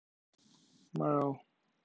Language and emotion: Russian, neutral